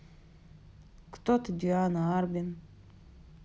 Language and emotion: Russian, neutral